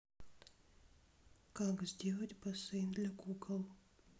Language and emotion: Russian, sad